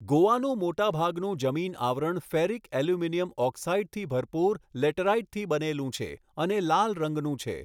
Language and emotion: Gujarati, neutral